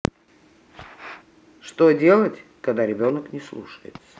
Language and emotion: Russian, neutral